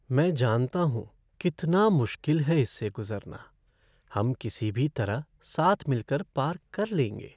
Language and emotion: Hindi, sad